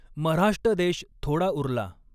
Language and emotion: Marathi, neutral